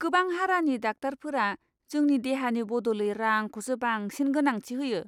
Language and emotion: Bodo, disgusted